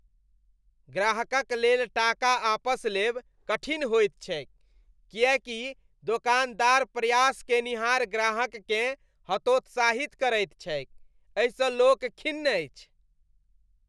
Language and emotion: Maithili, disgusted